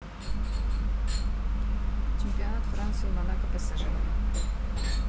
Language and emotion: Russian, neutral